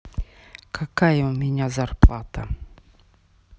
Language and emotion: Russian, neutral